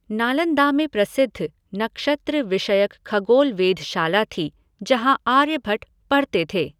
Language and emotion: Hindi, neutral